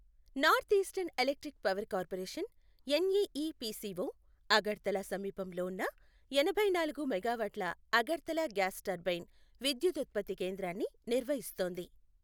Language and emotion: Telugu, neutral